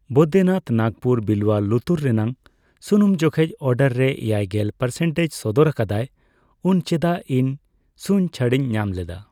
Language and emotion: Santali, neutral